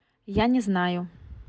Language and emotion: Russian, neutral